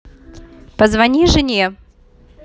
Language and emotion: Russian, neutral